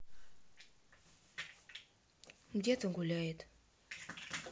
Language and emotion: Russian, neutral